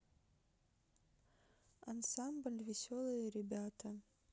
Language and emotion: Russian, neutral